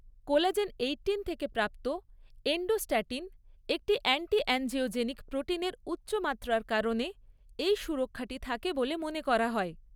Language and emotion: Bengali, neutral